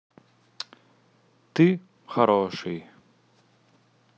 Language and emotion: Russian, neutral